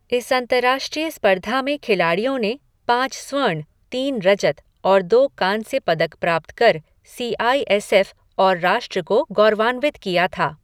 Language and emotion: Hindi, neutral